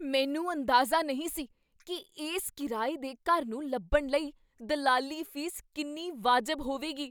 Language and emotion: Punjabi, surprised